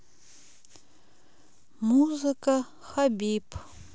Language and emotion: Russian, neutral